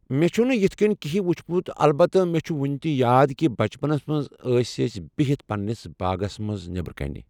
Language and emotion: Kashmiri, neutral